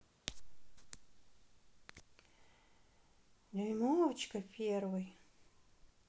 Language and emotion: Russian, neutral